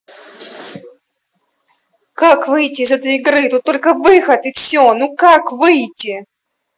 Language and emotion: Russian, angry